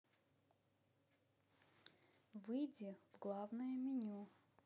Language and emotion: Russian, neutral